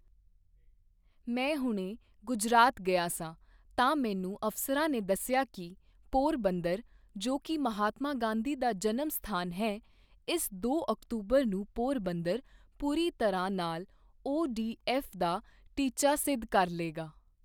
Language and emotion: Punjabi, neutral